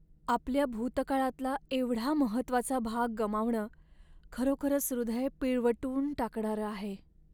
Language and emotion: Marathi, sad